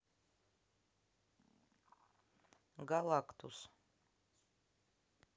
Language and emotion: Russian, neutral